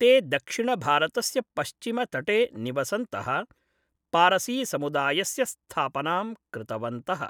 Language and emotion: Sanskrit, neutral